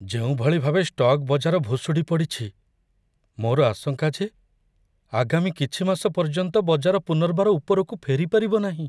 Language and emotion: Odia, fearful